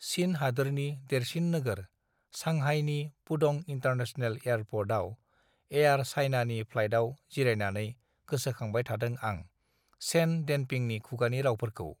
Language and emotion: Bodo, neutral